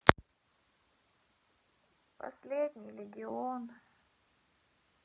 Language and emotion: Russian, sad